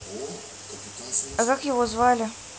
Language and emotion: Russian, neutral